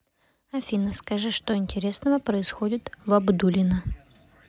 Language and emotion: Russian, neutral